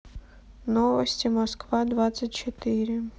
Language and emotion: Russian, sad